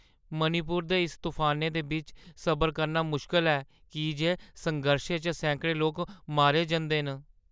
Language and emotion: Dogri, sad